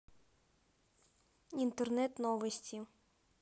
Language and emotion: Russian, neutral